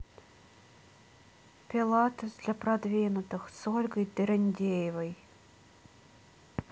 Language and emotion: Russian, neutral